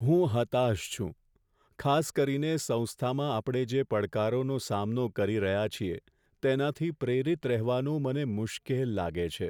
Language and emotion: Gujarati, sad